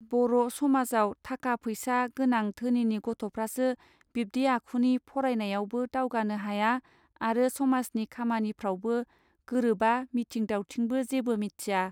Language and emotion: Bodo, neutral